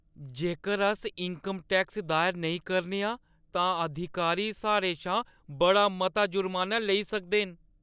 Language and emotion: Dogri, fearful